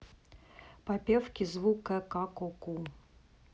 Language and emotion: Russian, neutral